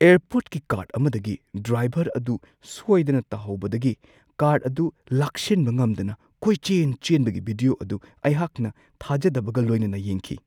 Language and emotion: Manipuri, surprised